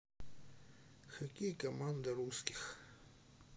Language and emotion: Russian, neutral